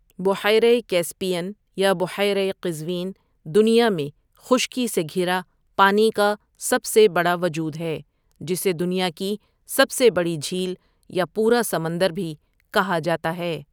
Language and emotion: Urdu, neutral